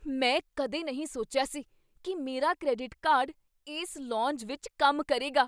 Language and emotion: Punjabi, surprised